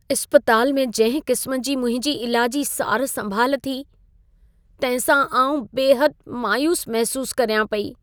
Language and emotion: Sindhi, sad